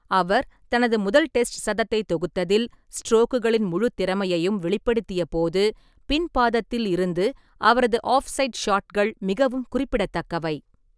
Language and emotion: Tamil, neutral